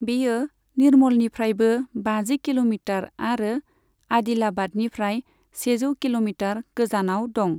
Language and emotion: Bodo, neutral